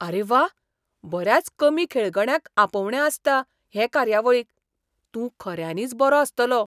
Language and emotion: Goan Konkani, surprised